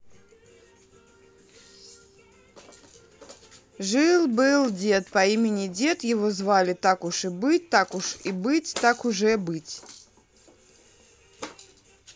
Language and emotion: Russian, neutral